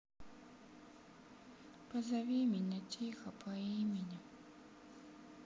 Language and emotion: Russian, sad